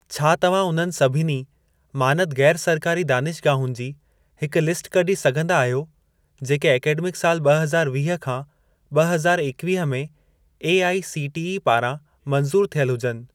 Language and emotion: Sindhi, neutral